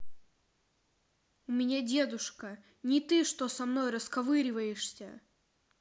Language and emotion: Russian, angry